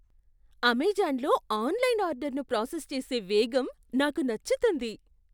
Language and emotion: Telugu, surprised